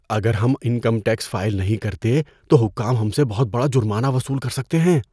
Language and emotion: Urdu, fearful